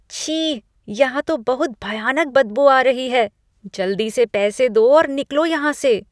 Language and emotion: Hindi, disgusted